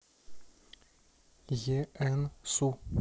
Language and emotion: Russian, neutral